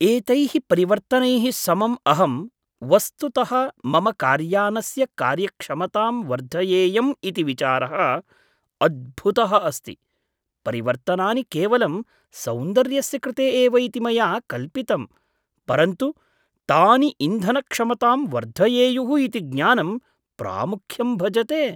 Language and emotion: Sanskrit, surprised